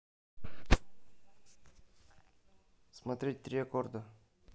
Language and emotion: Russian, neutral